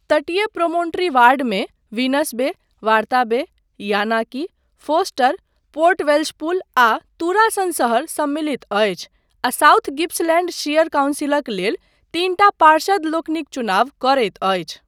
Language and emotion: Maithili, neutral